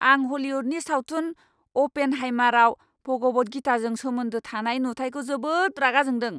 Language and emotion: Bodo, angry